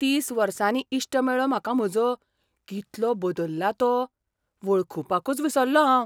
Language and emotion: Goan Konkani, surprised